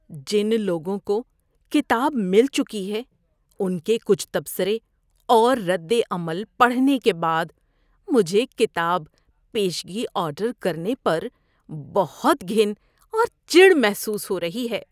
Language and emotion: Urdu, disgusted